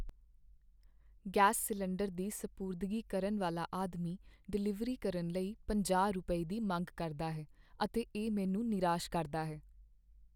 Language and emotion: Punjabi, sad